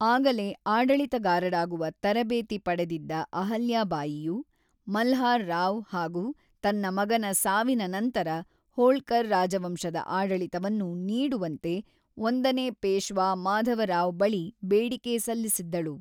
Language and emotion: Kannada, neutral